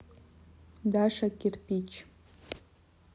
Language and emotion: Russian, neutral